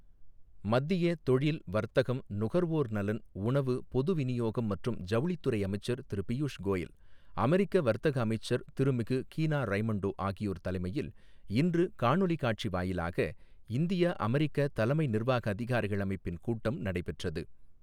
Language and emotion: Tamil, neutral